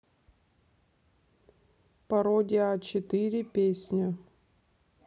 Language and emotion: Russian, neutral